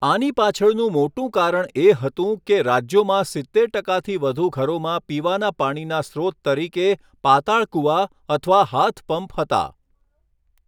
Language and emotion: Gujarati, neutral